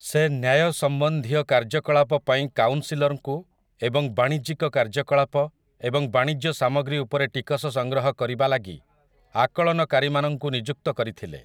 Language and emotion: Odia, neutral